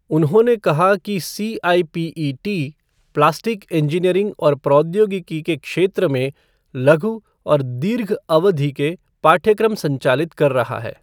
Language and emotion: Hindi, neutral